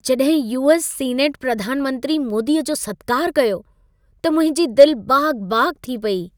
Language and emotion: Sindhi, happy